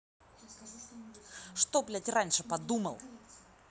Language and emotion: Russian, angry